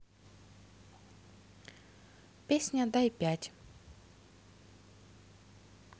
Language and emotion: Russian, neutral